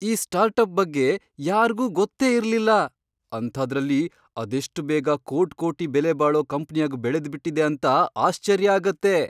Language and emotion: Kannada, surprised